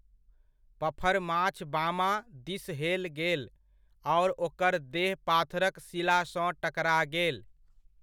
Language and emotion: Maithili, neutral